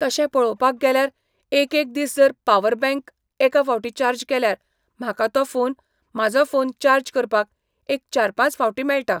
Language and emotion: Goan Konkani, neutral